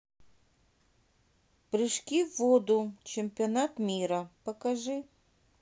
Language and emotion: Russian, neutral